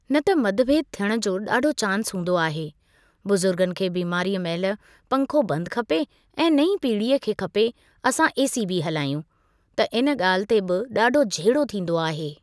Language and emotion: Sindhi, neutral